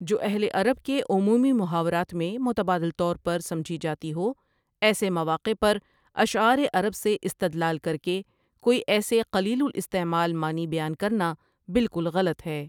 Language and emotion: Urdu, neutral